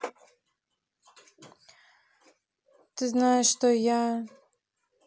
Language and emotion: Russian, neutral